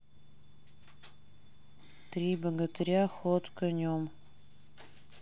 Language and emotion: Russian, sad